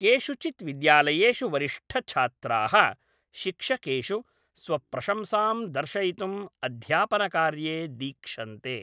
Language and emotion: Sanskrit, neutral